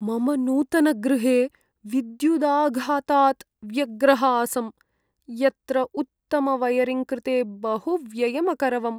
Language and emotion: Sanskrit, sad